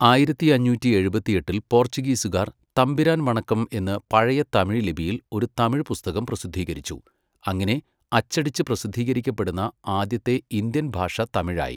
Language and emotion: Malayalam, neutral